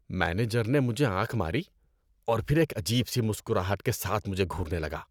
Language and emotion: Urdu, disgusted